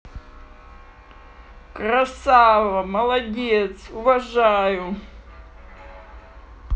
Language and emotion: Russian, positive